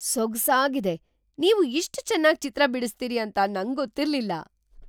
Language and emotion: Kannada, surprised